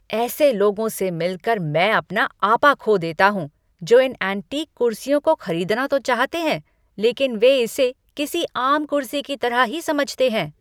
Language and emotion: Hindi, angry